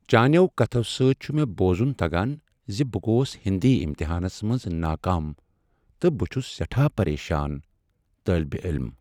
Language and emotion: Kashmiri, sad